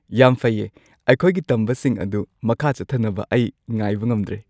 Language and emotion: Manipuri, happy